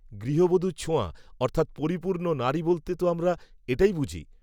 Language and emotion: Bengali, neutral